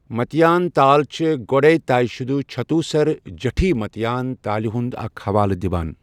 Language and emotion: Kashmiri, neutral